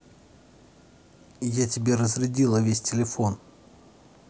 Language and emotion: Russian, neutral